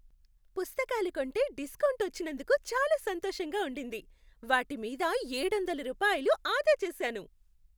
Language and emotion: Telugu, happy